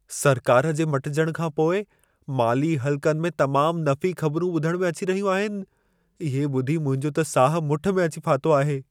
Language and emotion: Sindhi, fearful